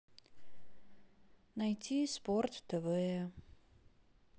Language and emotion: Russian, sad